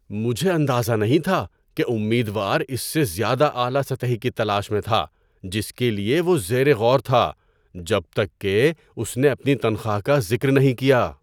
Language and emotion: Urdu, surprised